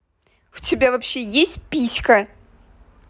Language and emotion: Russian, angry